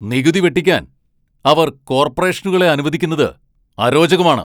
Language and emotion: Malayalam, angry